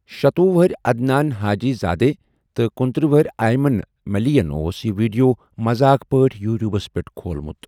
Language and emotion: Kashmiri, neutral